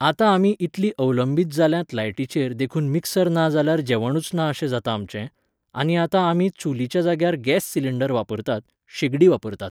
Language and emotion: Goan Konkani, neutral